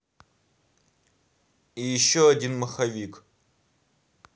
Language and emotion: Russian, neutral